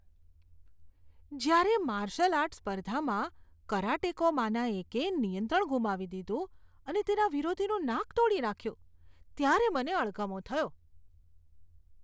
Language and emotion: Gujarati, disgusted